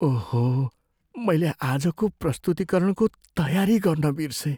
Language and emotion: Nepali, fearful